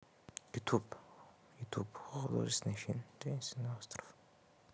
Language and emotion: Russian, neutral